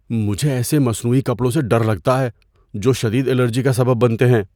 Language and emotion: Urdu, fearful